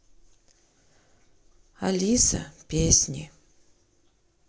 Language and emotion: Russian, sad